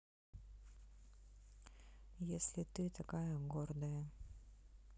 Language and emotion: Russian, sad